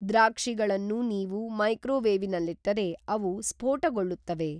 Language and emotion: Kannada, neutral